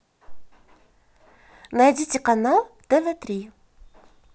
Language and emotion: Russian, positive